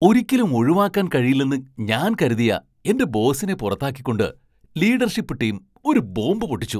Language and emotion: Malayalam, surprised